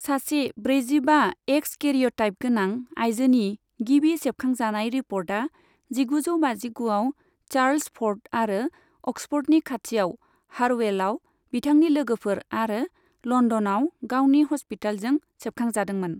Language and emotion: Bodo, neutral